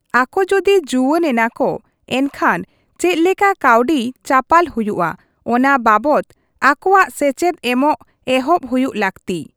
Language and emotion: Santali, neutral